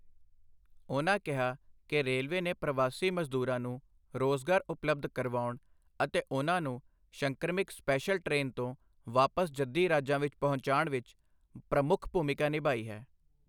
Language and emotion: Punjabi, neutral